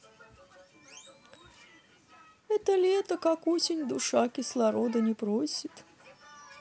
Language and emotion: Russian, sad